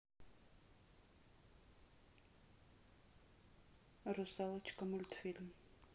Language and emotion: Russian, neutral